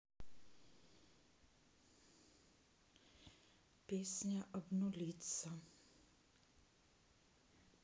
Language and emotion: Russian, sad